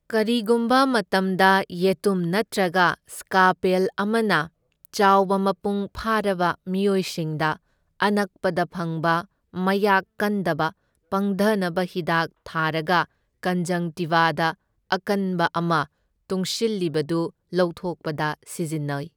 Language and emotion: Manipuri, neutral